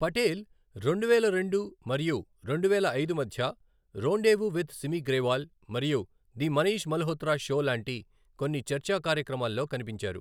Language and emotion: Telugu, neutral